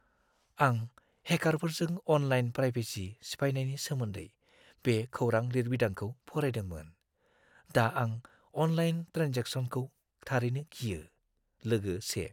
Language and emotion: Bodo, fearful